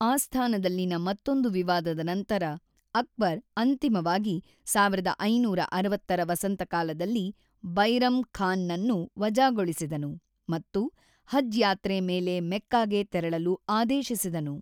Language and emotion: Kannada, neutral